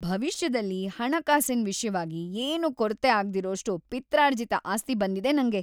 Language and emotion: Kannada, happy